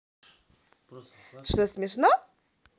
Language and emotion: Russian, positive